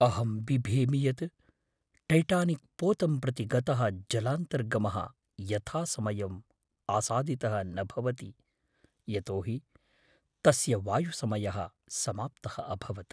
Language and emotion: Sanskrit, fearful